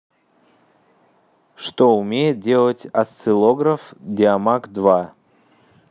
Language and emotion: Russian, neutral